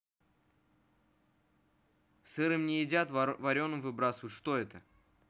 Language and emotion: Russian, neutral